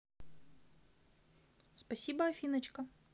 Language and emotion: Russian, positive